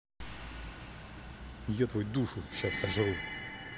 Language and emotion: Russian, angry